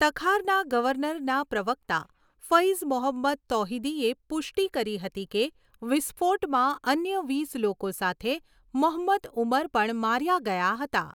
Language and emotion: Gujarati, neutral